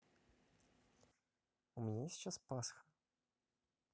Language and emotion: Russian, neutral